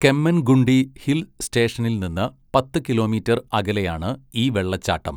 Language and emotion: Malayalam, neutral